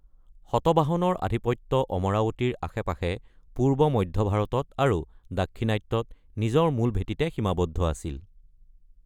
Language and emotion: Assamese, neutral